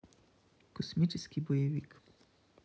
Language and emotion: Russian, neutral